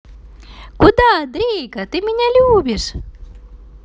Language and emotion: Russian, positive